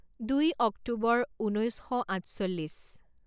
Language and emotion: Assamese, neutral